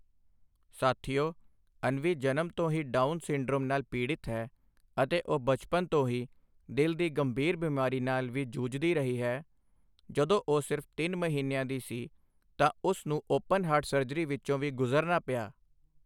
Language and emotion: Punjabi, neutral